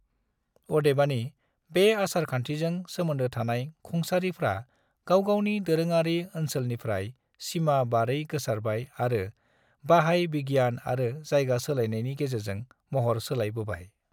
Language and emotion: Bodo, neutral